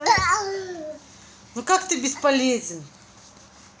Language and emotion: Russian, angry